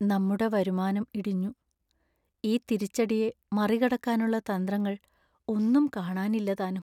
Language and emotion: Malayalam, sad